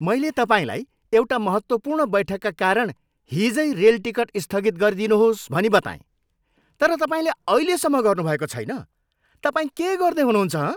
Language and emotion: Nepali, angry